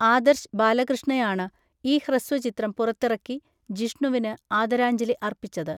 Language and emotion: Malayalam, neutral